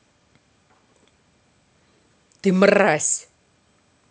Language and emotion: Russian, angry